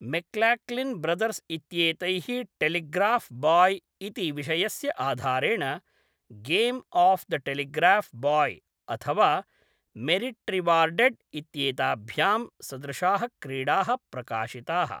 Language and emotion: Sanskrit, neutral